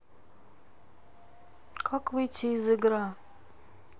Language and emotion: Russian, sad